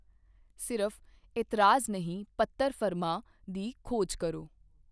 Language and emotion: Punjabi, neutral